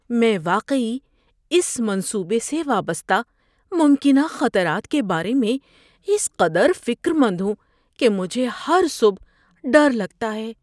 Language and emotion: Urdu, fearful